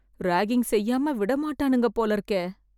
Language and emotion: Tamil, fearful